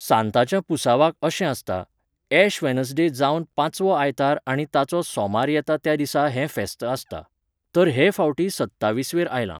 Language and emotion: Goan Konkani, neutral